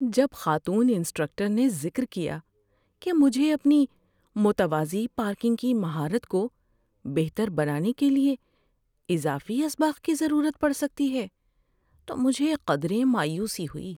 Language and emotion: Urdu, sad